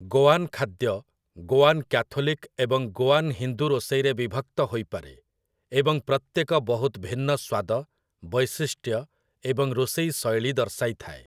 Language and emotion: Odia, neutral